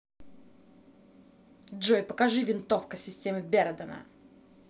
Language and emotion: Russian, angry